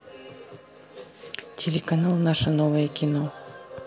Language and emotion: Russian, neutral